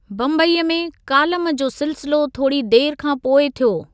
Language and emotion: Sindhi, neutral